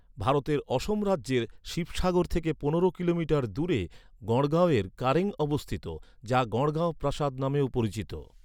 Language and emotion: Bengali, neutral